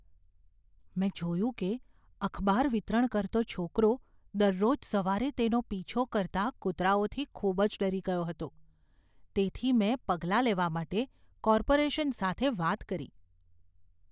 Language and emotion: Gujarati, fearful